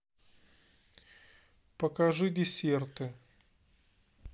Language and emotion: Russian, neutral